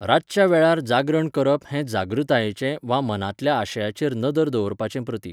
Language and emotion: Goan Konkani, neutral